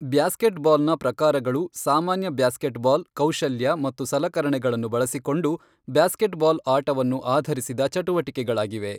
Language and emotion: Kannada, neutral